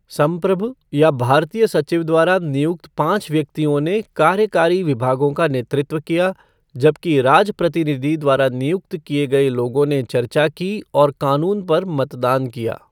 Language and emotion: Hindi, neutral